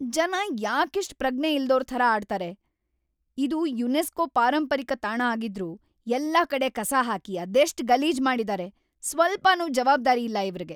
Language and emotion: Kannada, angry